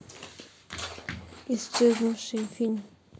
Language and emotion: Russian, neutral